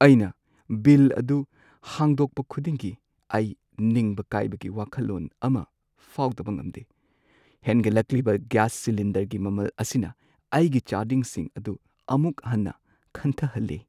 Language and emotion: Manipuri, sad